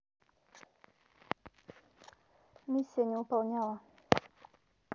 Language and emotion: Russian, neutral